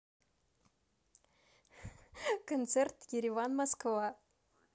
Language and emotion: Russian, positive